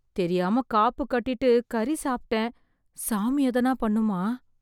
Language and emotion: Tamil, fearful